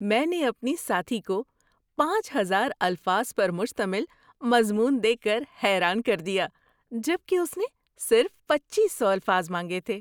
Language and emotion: Urdu, surprised